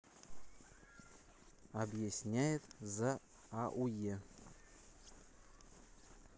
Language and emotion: Russian, neutral